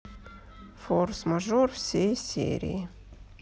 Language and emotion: Russian, sad